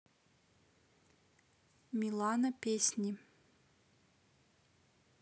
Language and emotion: Russian, neutral